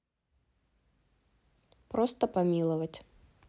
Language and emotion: Russian, neutral